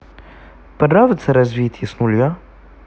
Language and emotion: Russian, neutral